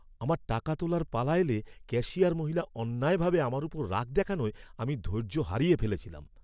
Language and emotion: Bengali, angry